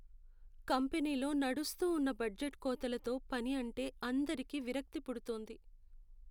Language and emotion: Telugu, sad